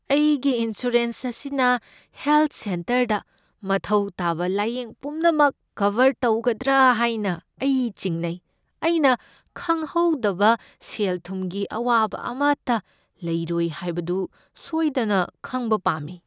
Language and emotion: Manipuri, fearful